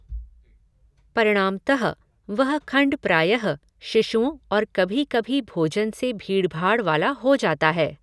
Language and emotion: Hindi, neutral